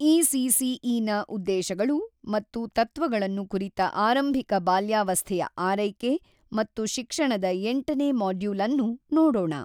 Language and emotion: Kannada, neutral